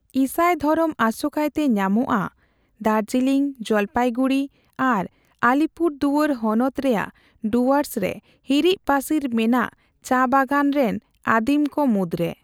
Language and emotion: Santali, neutral